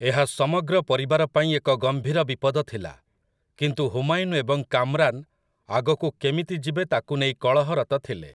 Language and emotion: Odia, neutral